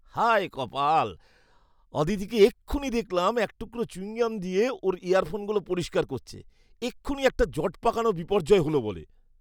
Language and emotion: Bengali, disgusted